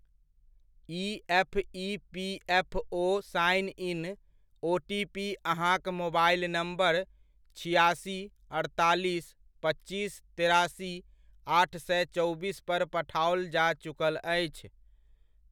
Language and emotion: Maithili, neutral